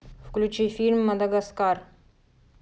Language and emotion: Russian, angry